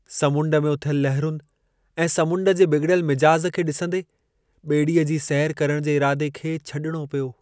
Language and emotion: Sindhi, sad